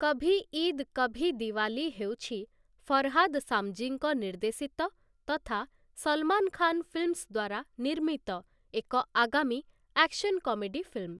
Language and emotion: Odia, neutral